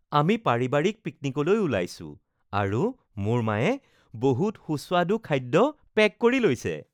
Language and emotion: Assamese, happy